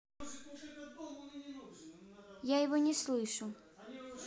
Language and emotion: Russian, neutral